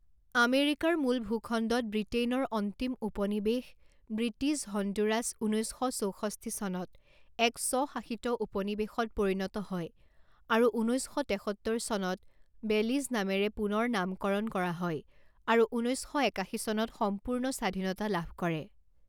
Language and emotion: Assamese, neutral